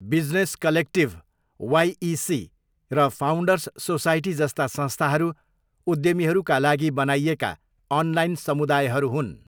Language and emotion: Nepali, neutral